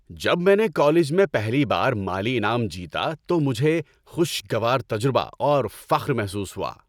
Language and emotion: Urdu, happy